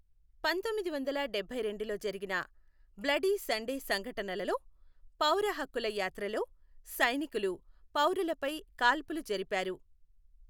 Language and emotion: Telugu, neutral